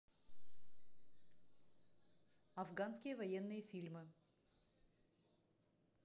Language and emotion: Russian, neutral